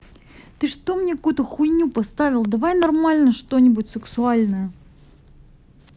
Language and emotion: Russian, angry